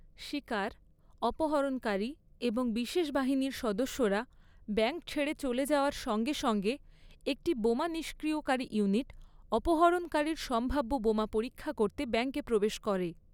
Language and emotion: Bengali, neutral